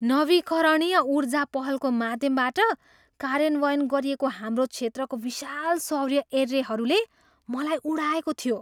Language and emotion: Nepali, surprised